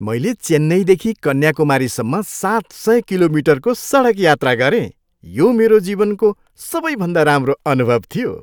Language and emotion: Nepali, happy